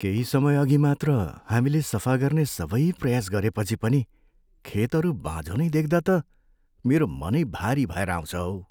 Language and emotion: Nepali, sad